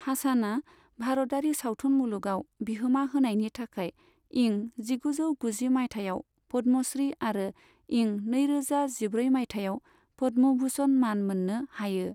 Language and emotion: Bodo, neutral